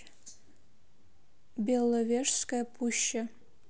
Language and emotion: Russian, neutral